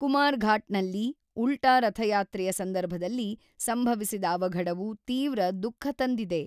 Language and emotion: Kannada, neutral